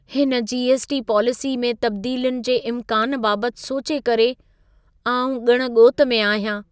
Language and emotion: Sindhi, fearful